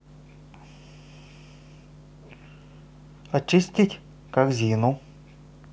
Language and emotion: Russian, neutral